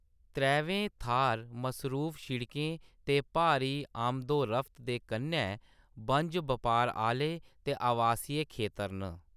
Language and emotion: Dogri, neutral